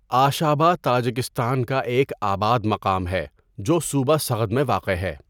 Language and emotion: Urdu, neutral